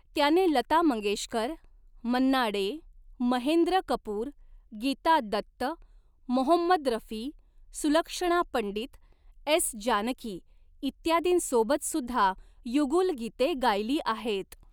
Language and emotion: Marathi, neutral